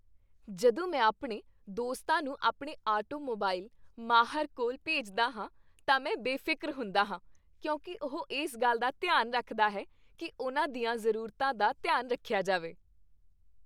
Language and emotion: Punjabi, happy